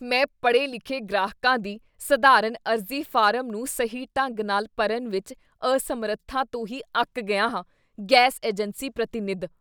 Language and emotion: Punjabi, disgusted